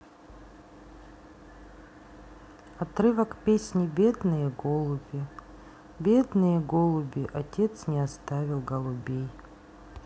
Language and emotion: Russian, sad